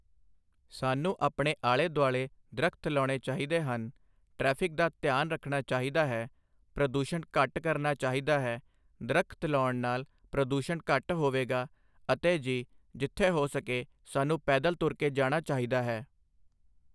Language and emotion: Punjabi, neutral